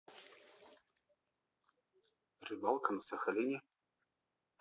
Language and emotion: Russian, neutral